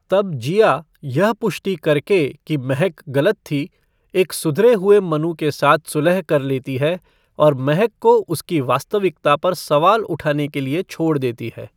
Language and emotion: Hindi, neutral